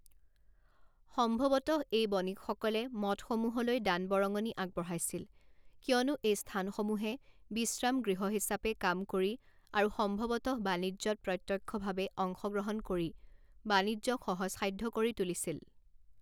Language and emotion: Assamese, neutral